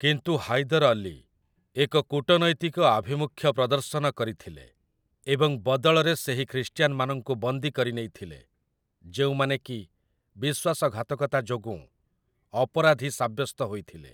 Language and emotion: Odia, neutral